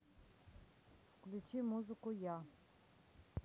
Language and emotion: Russian, neutral